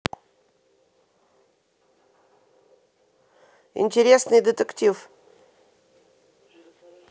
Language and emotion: Russian, neutral